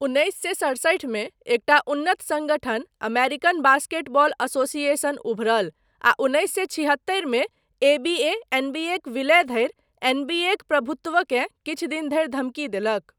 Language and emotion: Maithili, neutral